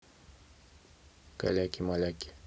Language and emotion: Russian, neutral